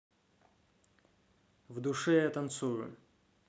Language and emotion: Russian, neutral